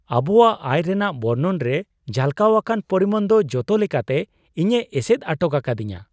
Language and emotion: Santali, surprised